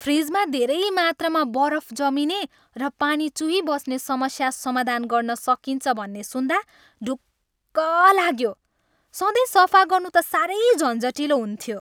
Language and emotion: Nepali, happy